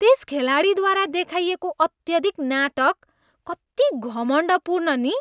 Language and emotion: Nepali, disgusted